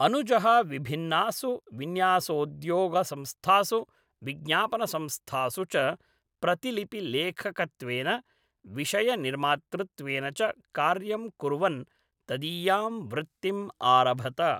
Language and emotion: Sanskrit, neutral